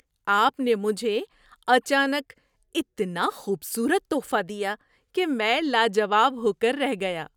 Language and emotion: Urdu, surprised